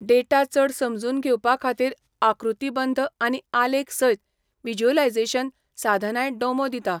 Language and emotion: Goan Konkani, neutral